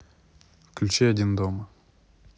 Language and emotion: Russian, neutral